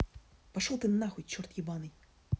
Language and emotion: Russian, angry